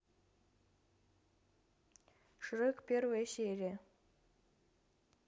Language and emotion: Russian, neutral